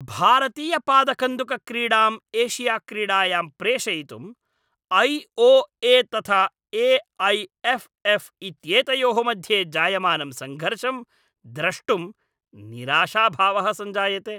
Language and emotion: Sanskrit, angry